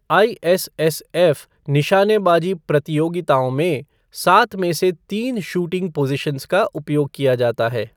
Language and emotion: Hindi, neutral